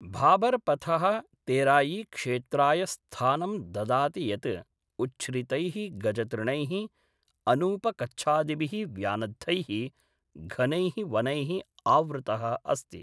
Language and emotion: Sanskrit, neutral